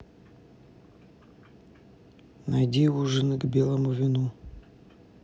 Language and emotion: Russian, neutral